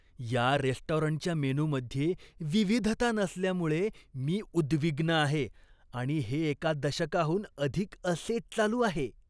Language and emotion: Marathi, disgusted